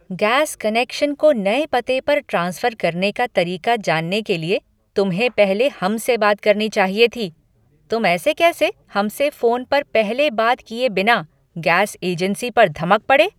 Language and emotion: Hindi, angry